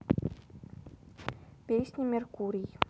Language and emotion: Russian, neutral